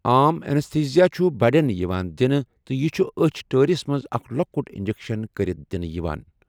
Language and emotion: Kashmiri, neutral